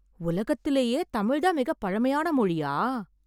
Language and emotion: Tamil, surprised